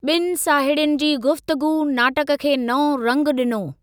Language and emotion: Sindhi, neutral